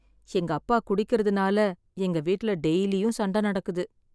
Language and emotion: Tamil, sad